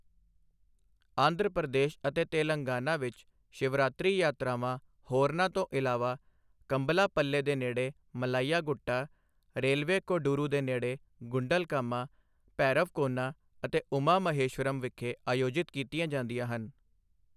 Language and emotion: Punjabi, neutral